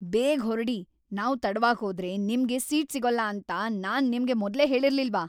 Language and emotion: Kannada, angry